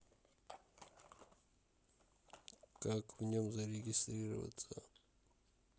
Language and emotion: Russian, sad